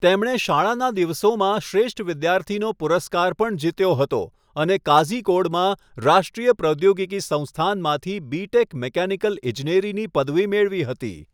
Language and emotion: Gujarati, neutral